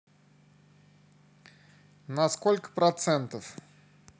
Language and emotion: Russian, neutral